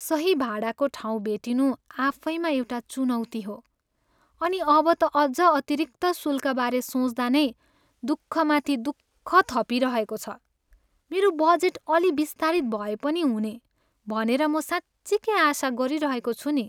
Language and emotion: Nepali, sad